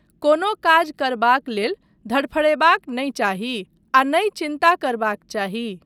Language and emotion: Maithili, neutral